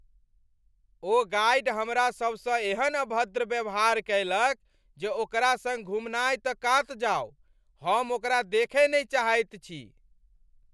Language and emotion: Maithili, angry